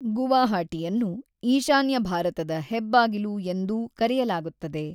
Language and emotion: Kannada, neutral